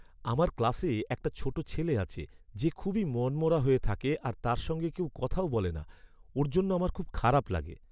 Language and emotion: Bengali, sad